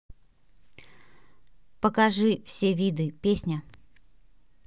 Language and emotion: Russian, neutral